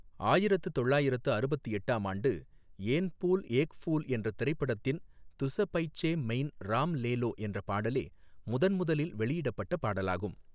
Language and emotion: Tamil, neutral